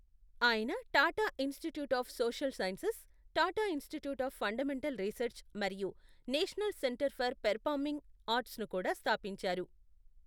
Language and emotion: Telugu, neutral